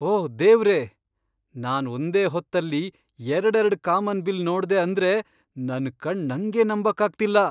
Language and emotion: Kannada, surprised